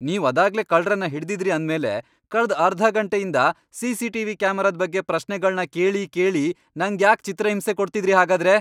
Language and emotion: Kannada, angry